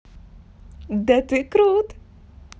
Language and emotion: Russian, positive